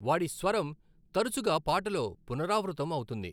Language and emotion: Telugu, neutral